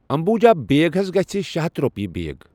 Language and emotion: Kashmiri, neutral